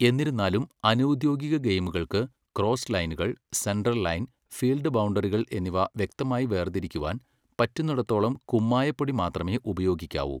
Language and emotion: Malayalam, neutral